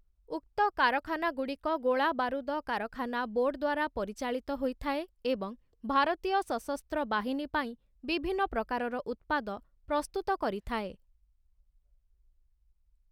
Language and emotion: Odia, neutral